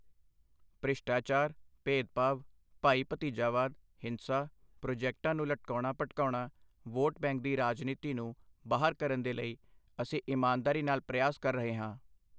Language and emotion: Punjabi, neutral